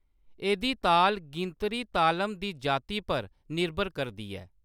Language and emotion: Dogri, neutral